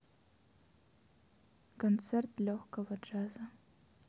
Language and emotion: Russian, sad